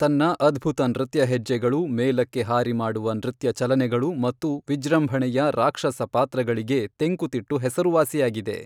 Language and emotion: Kannada, neutral